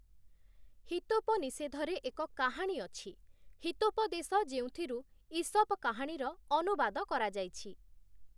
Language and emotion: Odia, neutral